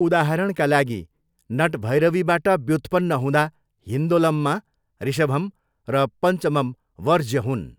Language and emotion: Nepali, neutral